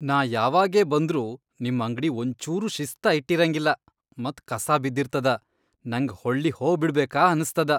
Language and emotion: Kannada, disgusted